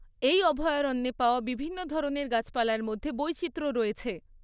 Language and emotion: Bengali, neutral